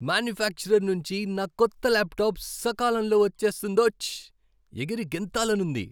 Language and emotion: Telugu, happy